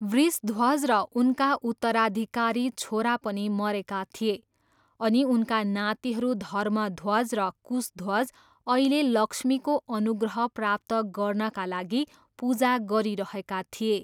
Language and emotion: Nepali, neutral